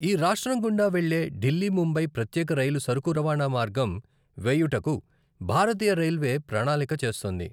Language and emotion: Telugu, neutral